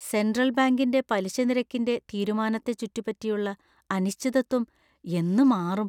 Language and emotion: Malayalam, fearful